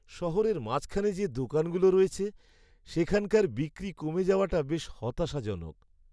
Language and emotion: Bengali, sad